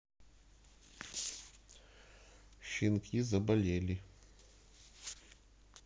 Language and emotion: Russian, neutral